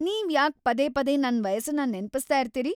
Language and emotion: Kannada, angry